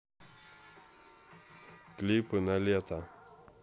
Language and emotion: Russian, neutral